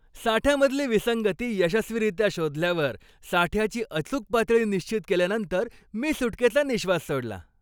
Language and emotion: Marathi, happy